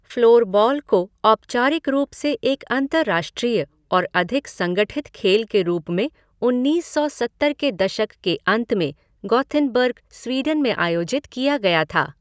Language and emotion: Hindi, neutral